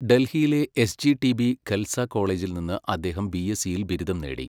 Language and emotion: Malayalam, neutral